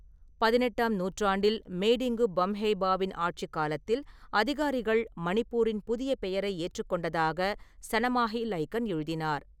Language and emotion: Tamil, neutral